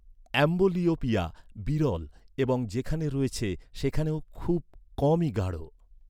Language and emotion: Bengali, neutral